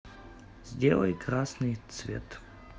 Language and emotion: Russian, neutral